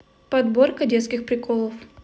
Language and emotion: Russian, neutral